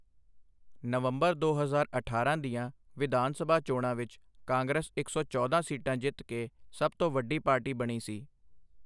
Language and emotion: Punjabi, neutral